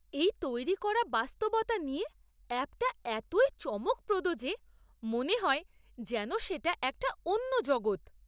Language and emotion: Bengali, surprised